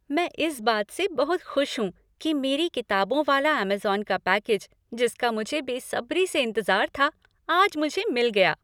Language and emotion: Hindi, happy